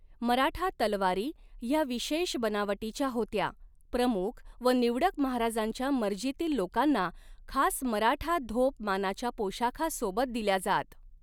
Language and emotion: Marathi, neutral